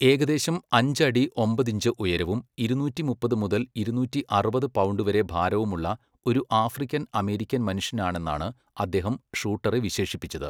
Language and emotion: Malayalam, neutral